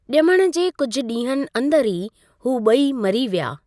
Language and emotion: Sindhi, neutral